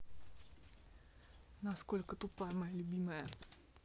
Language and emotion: Russian, neutral